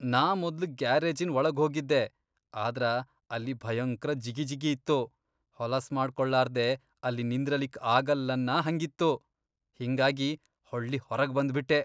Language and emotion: Kannada, disgusted